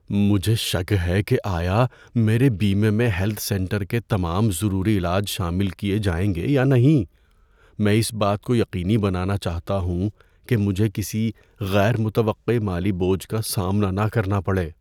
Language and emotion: Urdu, fearful